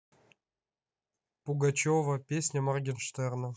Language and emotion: Russian, neutral